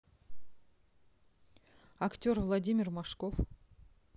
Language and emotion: Russian, neutral